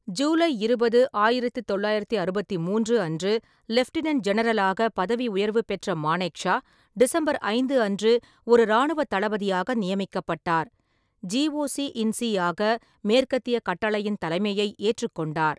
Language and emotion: Tamil, neutral